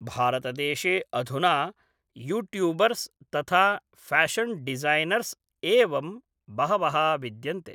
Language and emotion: Sanskrit, neutral